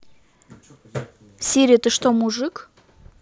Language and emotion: Russian, angry